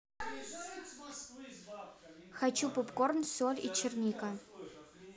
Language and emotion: Russian, neutral